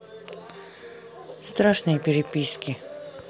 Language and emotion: Russian, neutral